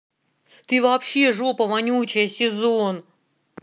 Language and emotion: Russian, angry